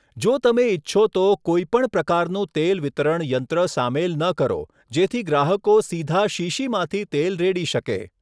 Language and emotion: Gujarati, neutral